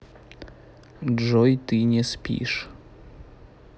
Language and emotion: Russian, neutral